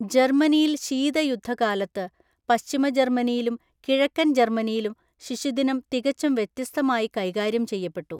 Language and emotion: Malayalam, neutral